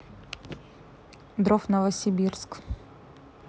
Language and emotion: Russian, neutral